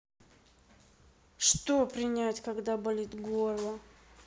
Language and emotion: Russian, sad